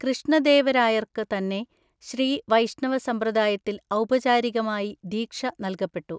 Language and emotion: Malayalam, neutral